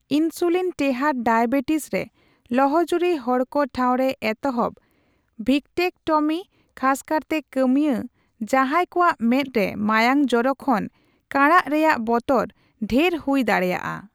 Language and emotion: Santali, neutral